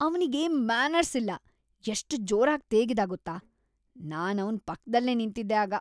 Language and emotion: Kannada, disgusted